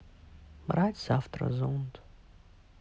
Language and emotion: Russian, sad